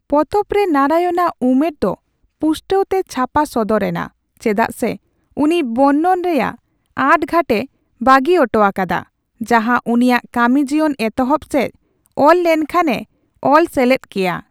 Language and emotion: Santali, neutral